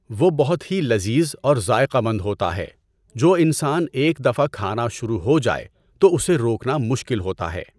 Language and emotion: Urdu, neutral